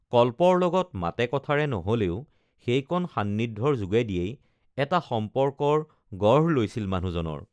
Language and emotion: Assamese, neutral